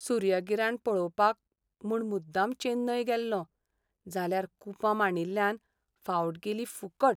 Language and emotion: Goan Konkani, sad